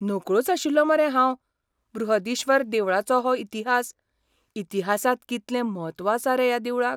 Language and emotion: Goan Konkani, surprised